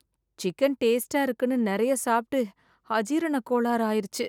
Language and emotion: Tamil, sad